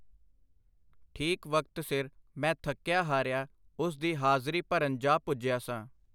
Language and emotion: Punjabi, neutral